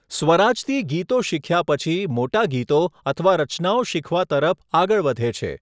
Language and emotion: Gujarati, neutral